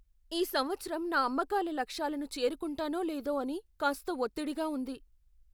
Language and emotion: Telugu, fearful